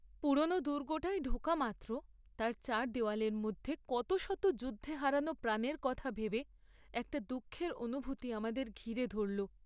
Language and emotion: Bengali, sad